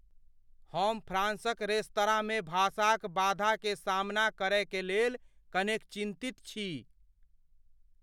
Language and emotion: Maithili, fearful